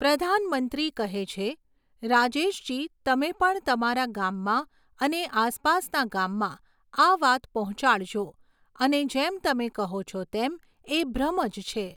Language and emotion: Gujarati, neutral